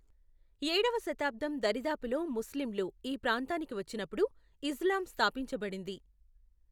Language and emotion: Telugu, neutral